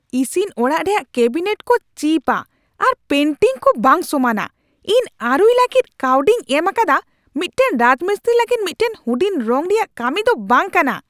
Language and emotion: Santali, angry